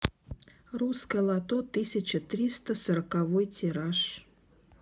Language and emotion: Russian, neutral